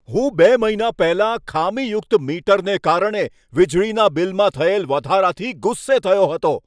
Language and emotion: Gujarati, angry